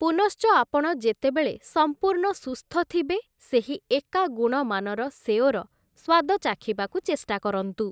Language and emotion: Odia, neutral